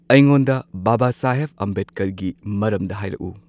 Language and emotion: Manipuri, neutral